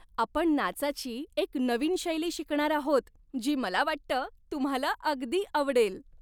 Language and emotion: Marathi, happy